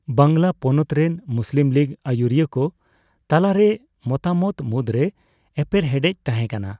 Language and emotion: Santali, neutral